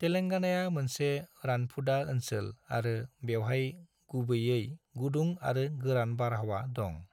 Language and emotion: Bodo, neutral